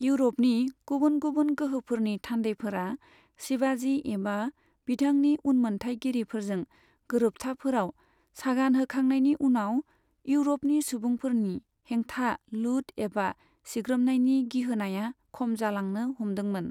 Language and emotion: Bodo, neutral